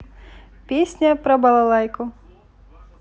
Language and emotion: Russian, positive